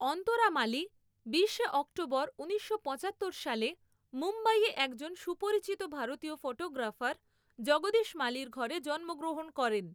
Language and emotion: Bengali, neutral